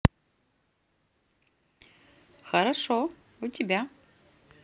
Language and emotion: Russian, positive